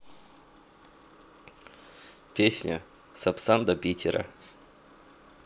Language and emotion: Russian, neutral